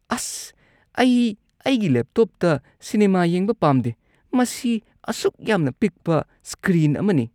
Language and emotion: Manipuri, disgusted